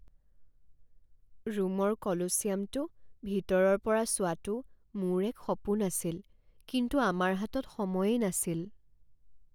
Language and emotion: Assamese, sad